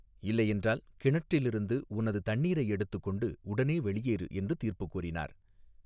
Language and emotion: Tamil, neutral